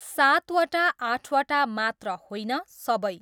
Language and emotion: Nepali, neutral